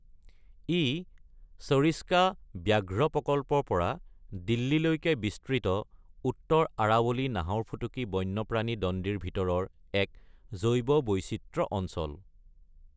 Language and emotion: Assamese, neutral